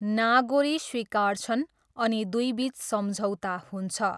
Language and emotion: Nepali, neutral